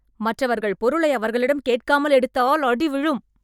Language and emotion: Tamil, angry